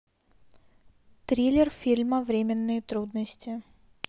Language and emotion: Russian, neutral